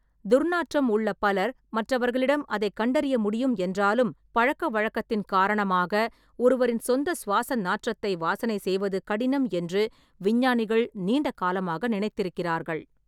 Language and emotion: Tamil, neutral